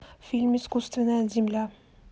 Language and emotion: Russian, neutral